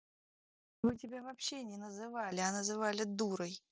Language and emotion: Russian, angry